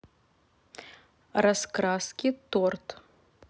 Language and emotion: Russian, neutral